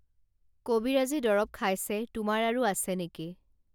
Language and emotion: Assamese, neutral